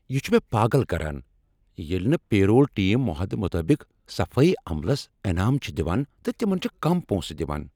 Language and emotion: Kashmiri, angry